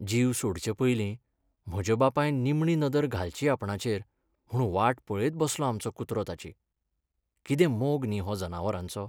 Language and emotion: Goan Konkani, sad